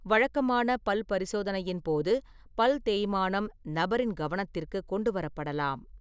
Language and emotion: Tamil, neutral